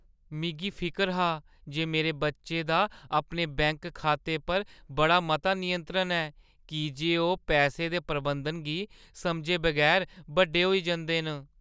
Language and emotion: Dogri, fearful